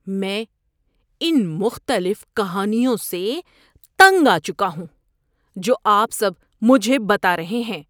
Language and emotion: Urdu, disgusted